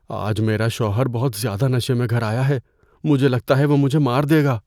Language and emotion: Urdu, fearful